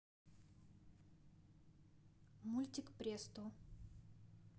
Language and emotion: Russian, neutral